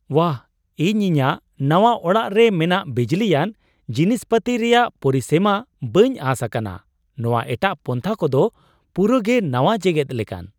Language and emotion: Santali, surprised